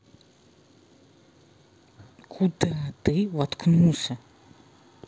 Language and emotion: Russian, angry